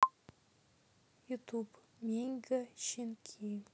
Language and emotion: Russian, sad